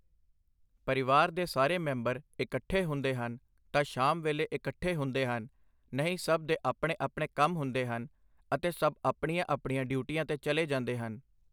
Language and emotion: Punjabi, neutral